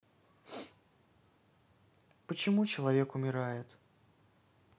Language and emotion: Russian, sad